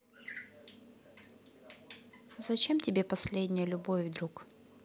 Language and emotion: Russian, neutral